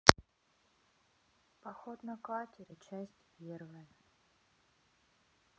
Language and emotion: Russian, sad